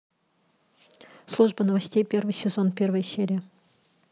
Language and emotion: Russian, neutral